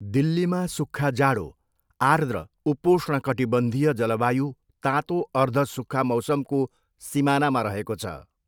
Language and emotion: Nepali, neutral